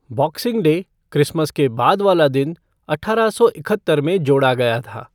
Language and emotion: Hindi, neutral